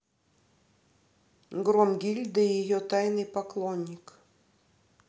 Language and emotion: Russian, neutral